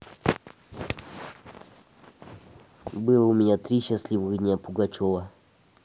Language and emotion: Russian, neutral